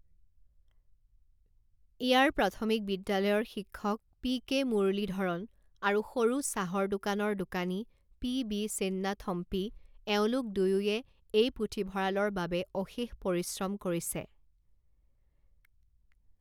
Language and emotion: Assamese, neutral